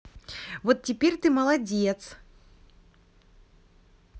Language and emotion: Russian, positive